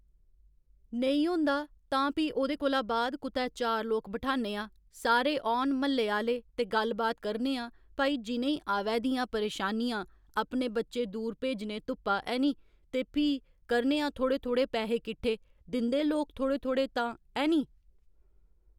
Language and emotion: Dogri, neutral